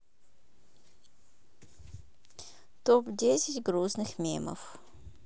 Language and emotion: Russian, neutral